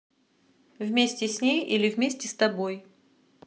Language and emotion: Russian, neutral